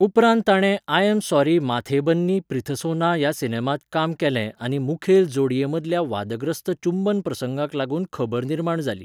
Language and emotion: Goan Konkani, neutral